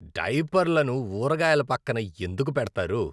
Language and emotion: Telugu, disgusted